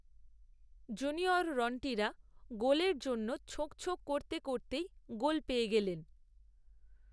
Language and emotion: Bengali, neutral